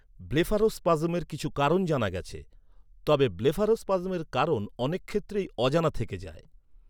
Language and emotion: Bengali, neutral